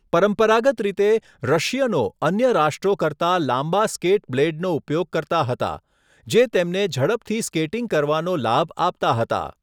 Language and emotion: Gujarati, neutral